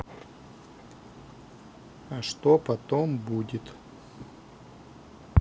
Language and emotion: Russian, neutral